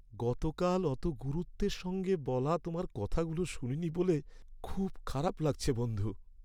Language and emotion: Bengali, sad